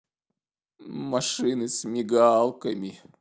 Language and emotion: Russian, sad